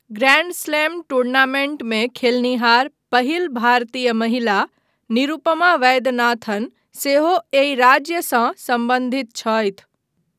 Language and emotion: Maithili, neutral